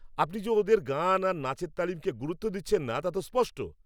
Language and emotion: Bengali, angry